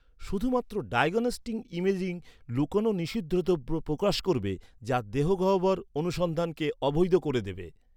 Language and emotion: Bengali, neutral